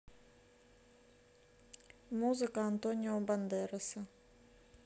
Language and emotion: Russian, neutral